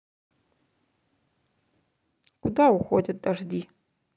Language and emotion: Russian, neutral